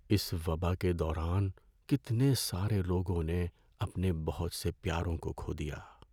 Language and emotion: Urdu, sad